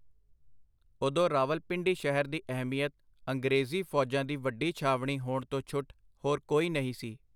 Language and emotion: Punjabi, neutral